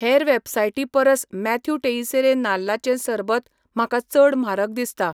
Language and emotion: Goan Konkani, neutral